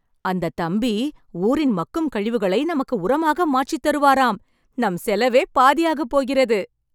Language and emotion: Tamil, happy